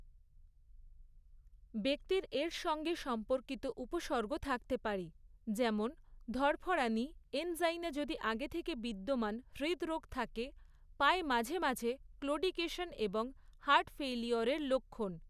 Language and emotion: Bengali, neutral